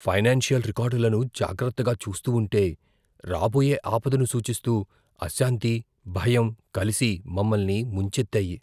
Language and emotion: Telugu, fearful